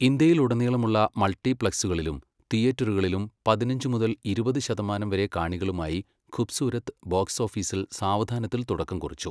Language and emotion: Malayalam, neutral